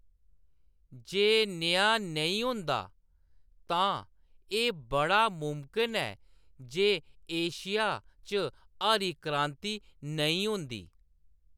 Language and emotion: Dogri, neutral